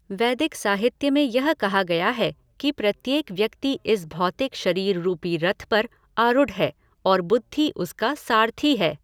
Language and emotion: Hindi, neutral